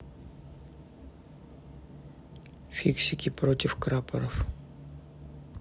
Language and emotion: Russian, neutral